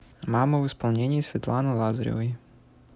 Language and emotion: Russian, neutral